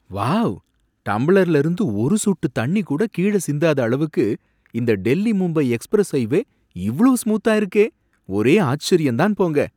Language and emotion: Tamil, surprised